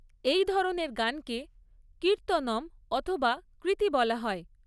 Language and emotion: Bengali, neutral